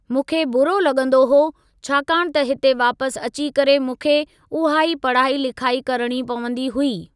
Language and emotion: Sindhi, neutral